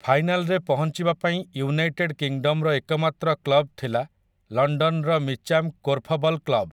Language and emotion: Odia, neutral